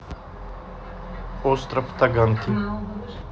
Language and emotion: Russian, neutral